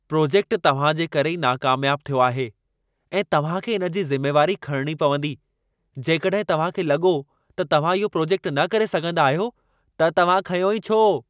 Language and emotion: Sindhi, angry